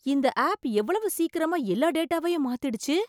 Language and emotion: Tamil, surprised